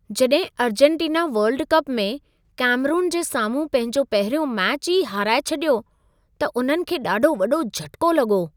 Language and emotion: Sindhi, surprised